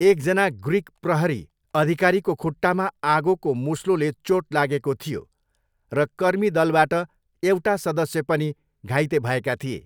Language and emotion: Nepali, neutral